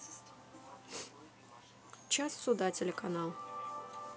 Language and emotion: Russian, neutral